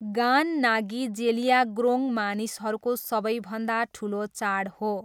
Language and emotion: Nepali, neutral